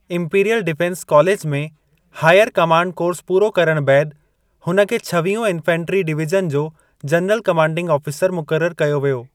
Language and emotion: Sindhi, neutral